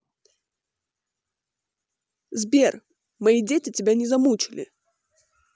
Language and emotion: Russian, neutral